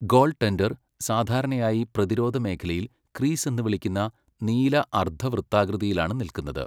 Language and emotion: Malayalam, neutral